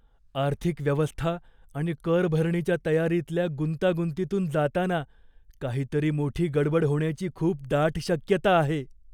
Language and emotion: Marathi, fearful